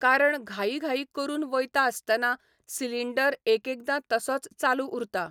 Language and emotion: Goan Konkani, neutral